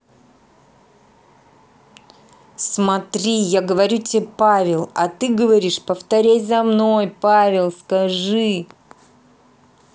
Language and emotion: Russian, angry